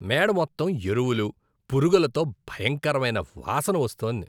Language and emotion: Telugu, disgusted